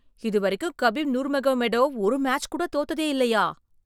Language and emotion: Tamil, surprised